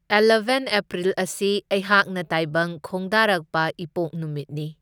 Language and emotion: Manipuri, neutral